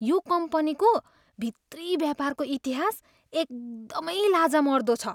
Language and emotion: Nepali, disgusted